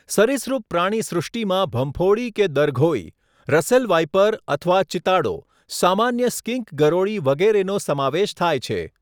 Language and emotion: Gujarati, neutral